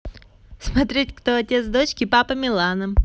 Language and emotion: Russian, positive